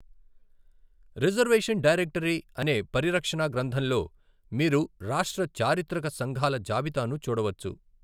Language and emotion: Telugu, neutral